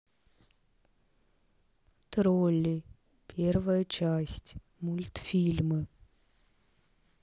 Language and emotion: Russian, neutral